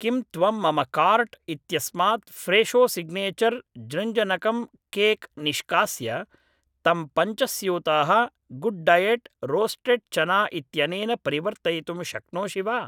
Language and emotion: Sanskrit, neutral